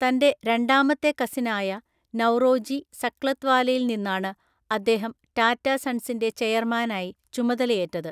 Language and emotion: Malayalam, neutral